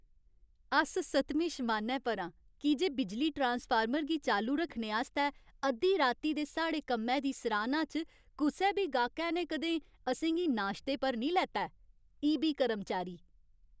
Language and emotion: Dogri, happy